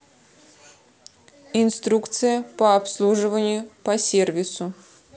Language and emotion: Russian, neutral